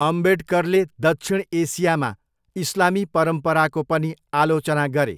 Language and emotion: Nepali, neutral